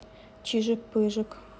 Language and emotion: Russian, neutral